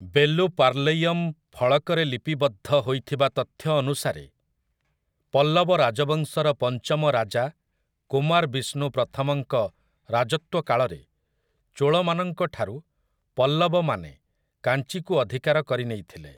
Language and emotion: Odia, neutral